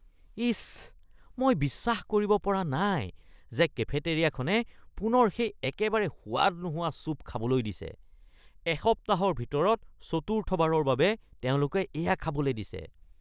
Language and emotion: Assamese, disgusted